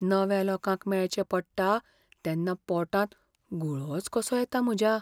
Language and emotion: Goan Konkani, fearful